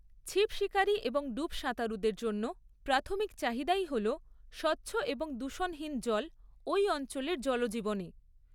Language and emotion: Bengali, neutral